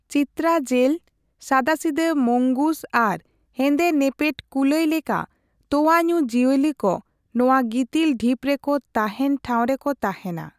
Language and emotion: Santali, neutral